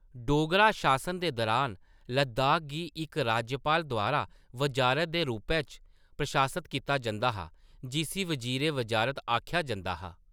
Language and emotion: Dogri, neutral